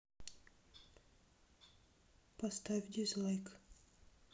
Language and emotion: Russian, neutral